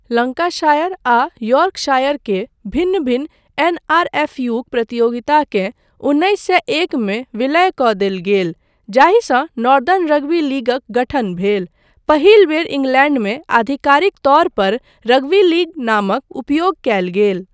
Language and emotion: Maithili, neutral